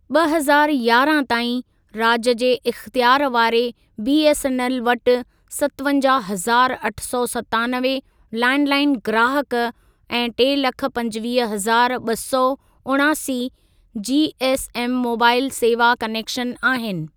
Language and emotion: Sindhi, neutral